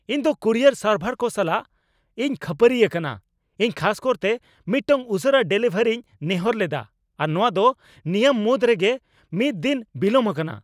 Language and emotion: Santali, angry